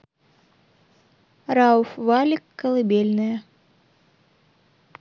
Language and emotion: Russian, neutral